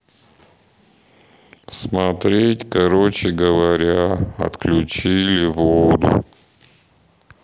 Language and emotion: Russian, sad